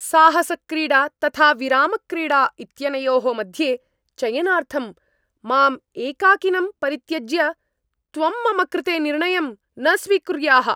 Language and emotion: Sanskrit, angry